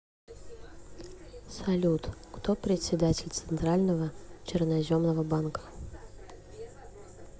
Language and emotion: Russian, neutral